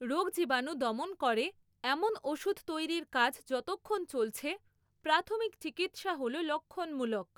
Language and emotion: Bengali, neutral